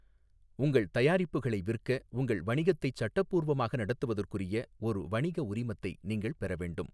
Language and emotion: Tamil, neutral